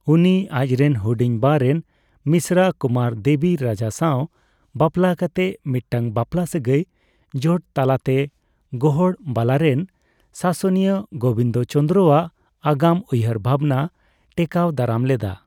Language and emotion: Santali, neutral